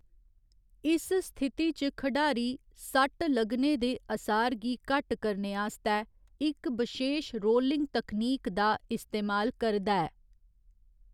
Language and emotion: Dogri, neutral